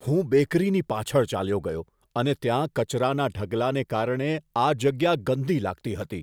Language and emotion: Gujarati, disgusted